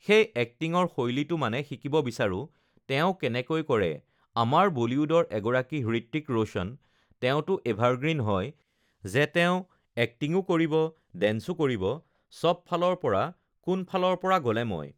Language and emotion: Assamese, neutral